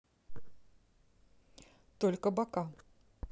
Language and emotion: Russian, neutral